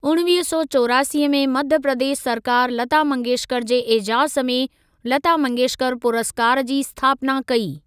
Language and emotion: Sindhi, neutral